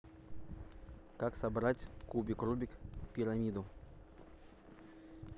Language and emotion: Russian, neutral